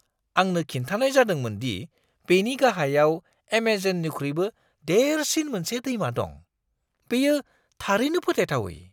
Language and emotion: Bodo, surprised